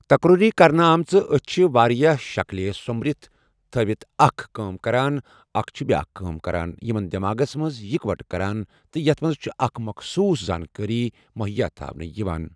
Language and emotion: Kashmiri, neutral